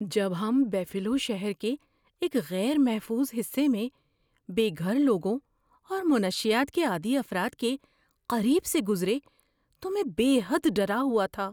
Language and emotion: Urdu, fearful